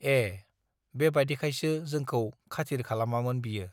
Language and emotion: Bodo, neutral